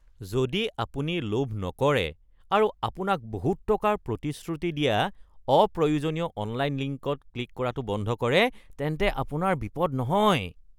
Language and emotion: Assamese, disgusted